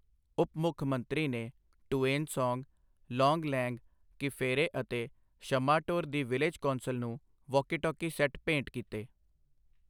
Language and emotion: Punjabi, neutral